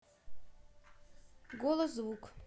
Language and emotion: Russian, neutral